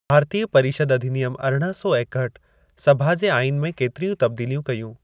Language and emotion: Sindhi, neutral